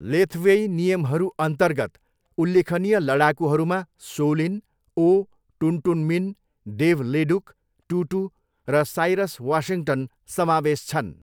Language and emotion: Nepali, neutral